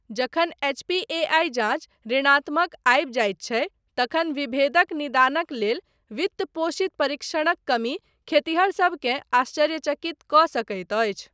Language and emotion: Maithili, neutral